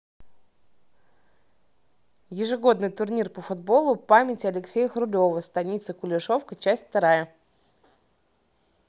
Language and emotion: Russian, neutral